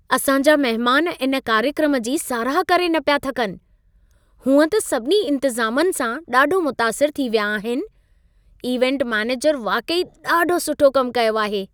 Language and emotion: Sindhi, happy